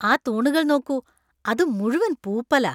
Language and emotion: Malayalam, disgusted